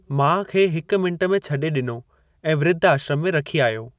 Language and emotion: Sindhi, neutral